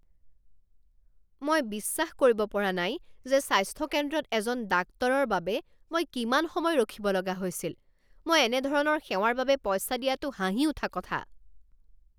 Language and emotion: Assamese, angry